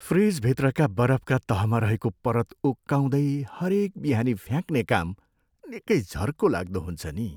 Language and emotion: Nepali, sad